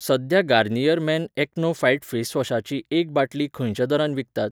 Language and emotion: Goan Konkani, neutral